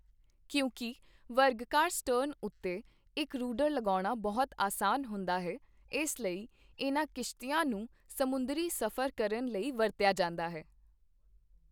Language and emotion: Punjabi, neutral